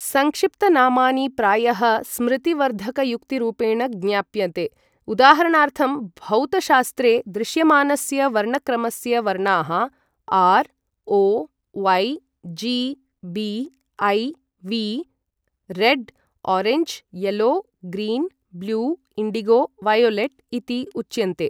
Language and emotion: Sanskrit, neutral